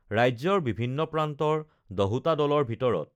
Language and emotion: Assamese, neutral